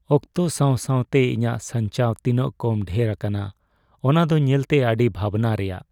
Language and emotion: Santali, sad